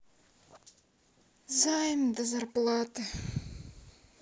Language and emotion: Russian, sad